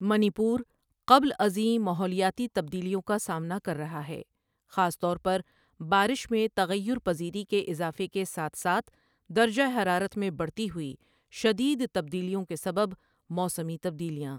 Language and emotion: Urdu, neutral